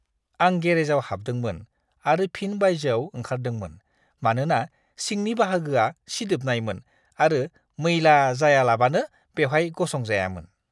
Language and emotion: Bodo, disgusted